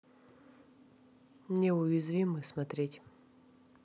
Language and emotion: Russian, neutral